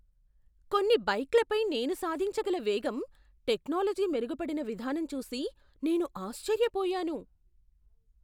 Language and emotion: Telugu, surprised